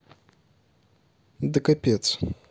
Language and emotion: Russian, neutral